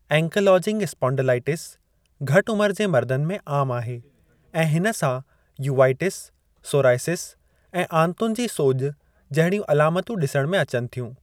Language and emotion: Sindhi, neutral